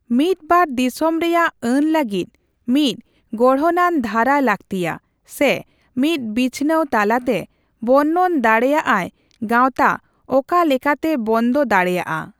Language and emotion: Santali, neutral